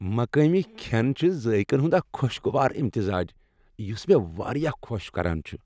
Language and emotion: Kashmiri, happy